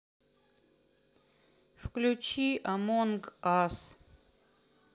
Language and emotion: Russian, sad